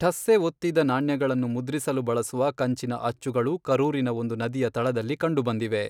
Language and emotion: Kannada, neutral